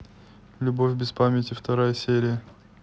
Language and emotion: Russian, neutral